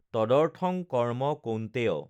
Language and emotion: Assamese, neutral